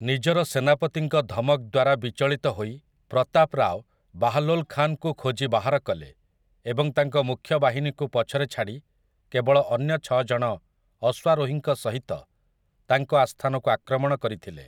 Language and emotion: Odia, neutral